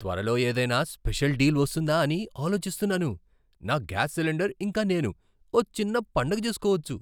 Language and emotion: Telugu, surprised